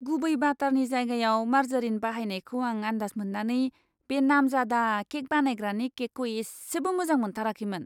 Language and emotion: Bodo, disgusted